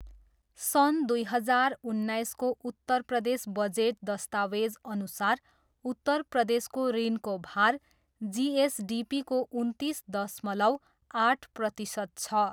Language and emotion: Nepali, neutral